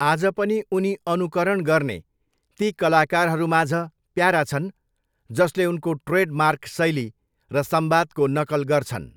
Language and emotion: Nepali, neutral